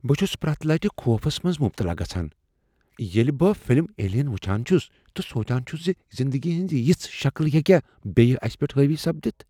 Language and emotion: Kashmiri, fearful